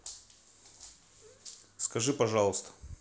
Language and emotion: Russian, neutral